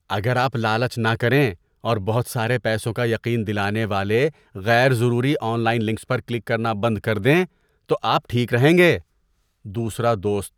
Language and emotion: Urdu, disgusted